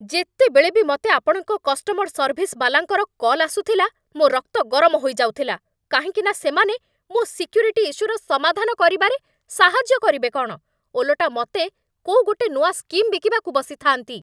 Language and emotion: Odia, angry